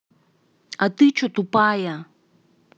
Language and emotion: Russian, angry